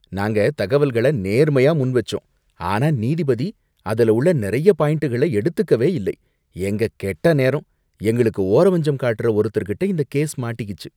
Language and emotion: Tamil, disgusted